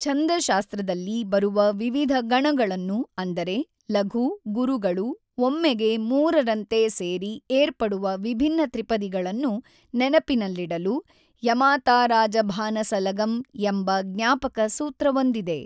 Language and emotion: Kannada, neutral